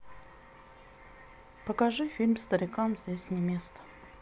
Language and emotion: Russian, sad